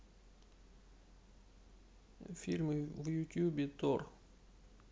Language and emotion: Russian, neutral